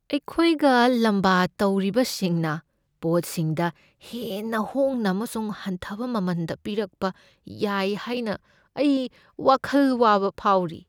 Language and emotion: Manipuri, fearful